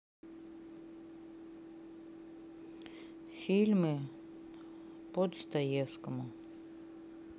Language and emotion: Russian, neutral